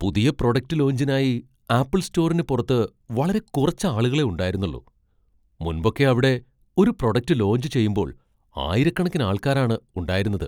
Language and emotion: Malayalam, surprised